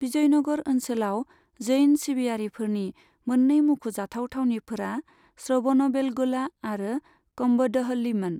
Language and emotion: Bodo, neutral